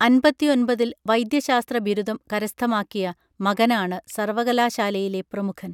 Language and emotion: Malayalam, neutral